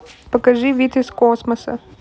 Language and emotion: Russian, neutral